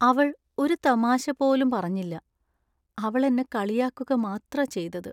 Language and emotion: Malayalam, sad